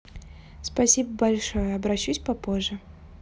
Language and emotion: Russian, positive